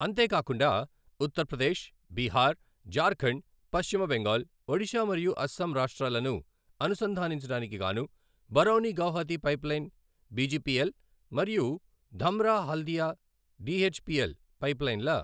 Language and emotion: Telugu, neutral